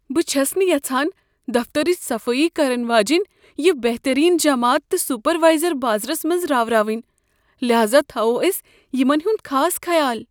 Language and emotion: Kashmiri, fearful